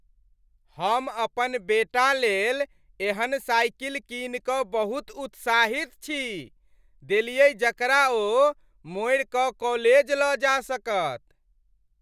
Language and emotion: Maithili, happy